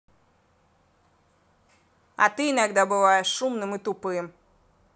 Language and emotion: Russian, angry